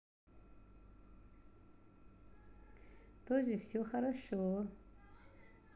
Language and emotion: Russian, positive